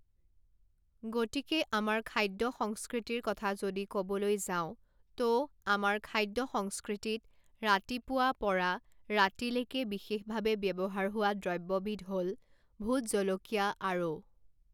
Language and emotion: Assamese, neutral